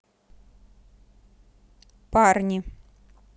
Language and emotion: Russian, neutral